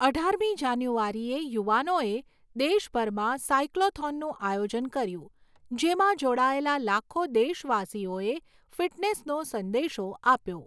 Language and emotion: Gujarati, neutral